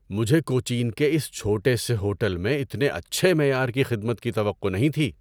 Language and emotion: Urdu, surprised